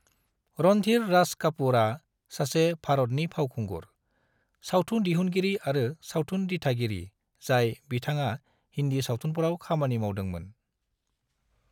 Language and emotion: Bodo, neutral